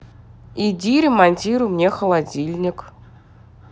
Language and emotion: Russian, neutral